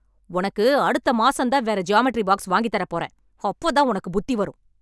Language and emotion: Tamil, angry